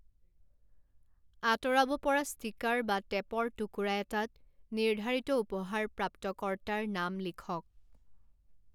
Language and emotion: Assamese, neutral